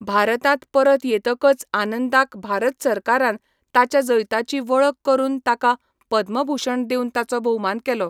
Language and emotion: Goan Konkani, neutral